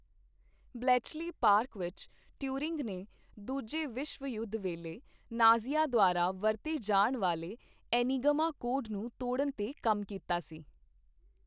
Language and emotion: Punjabi, neutral